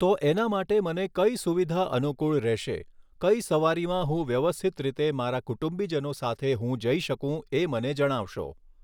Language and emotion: Gujarati, neutral